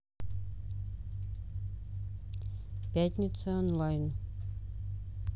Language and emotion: Russian, neutral